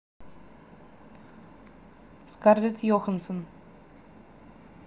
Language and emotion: Russian, neutral